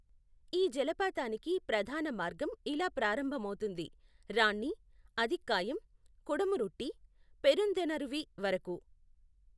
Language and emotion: Telugu, neutral